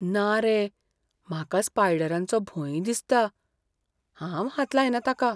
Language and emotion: Goan Konkani, fearful